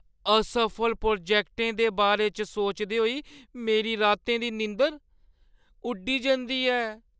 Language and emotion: Dogri, fearful